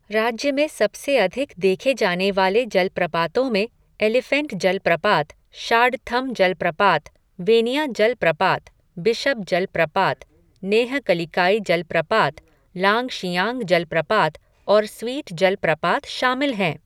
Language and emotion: Hindi, neutral